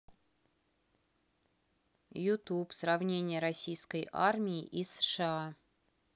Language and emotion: Russian, neutral